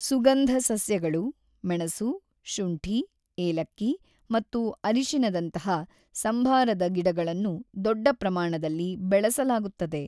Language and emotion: Kannada, neutral